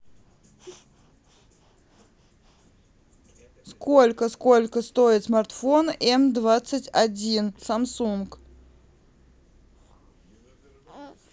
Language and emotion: Russian, neutral